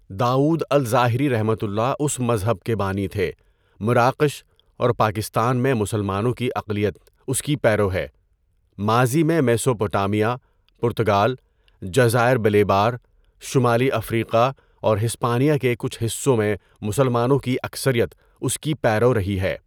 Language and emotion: Urdu, neutral